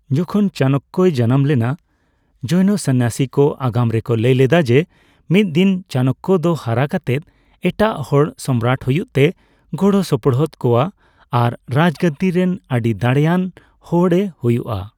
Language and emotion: Santali, neutral